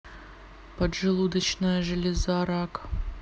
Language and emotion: Russian, neutral